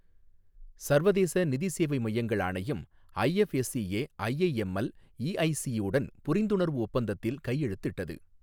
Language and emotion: Tamil, neutral